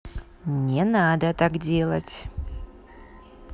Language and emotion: Russian, angry